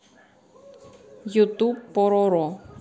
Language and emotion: Russian, neutral